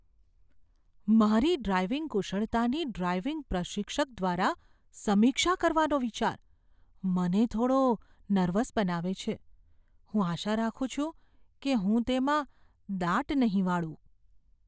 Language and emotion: Gujarati, fearful